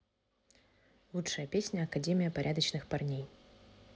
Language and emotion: Russian, neutral